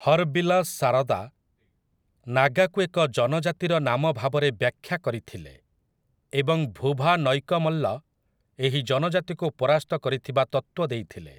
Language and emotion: Odia, neutral